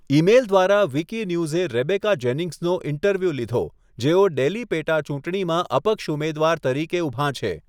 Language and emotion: Gujarati, neutral